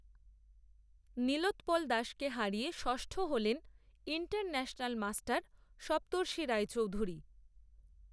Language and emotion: Bengali, neutral